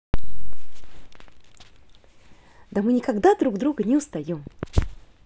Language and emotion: Russian, positive